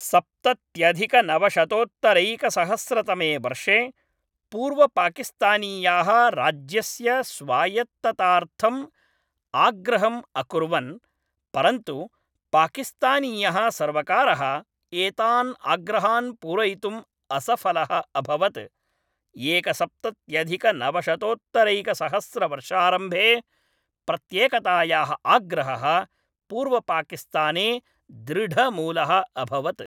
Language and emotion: Sanskrit, neutral